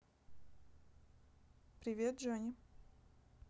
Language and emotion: Russian, neutral